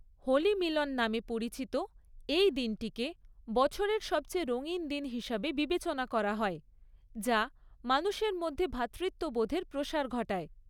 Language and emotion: Bengali, neutral